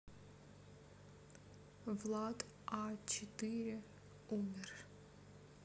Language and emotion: Russian, neutral